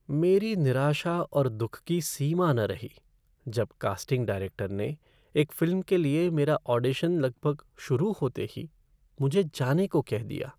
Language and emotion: Hindi, sad